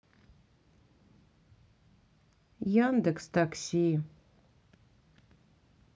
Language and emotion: Russian, sad